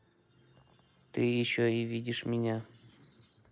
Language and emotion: Russian, neutral